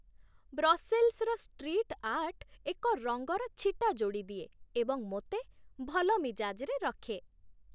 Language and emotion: Odia, happy